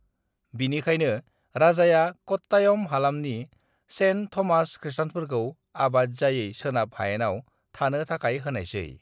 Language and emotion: Bodo, neutral